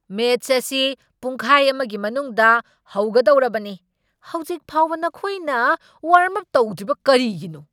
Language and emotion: Manipuri, angry